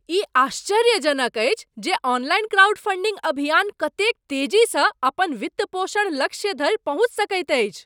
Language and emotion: Maithili, surprised